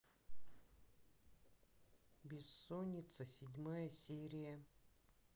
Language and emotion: Russian, neutral